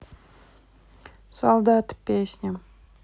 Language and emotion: Russian, neutral